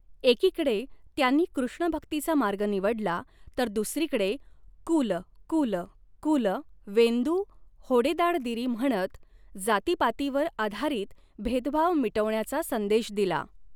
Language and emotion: Marathi, neutral